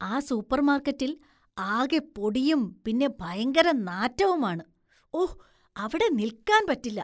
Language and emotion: Malayalam, disgusted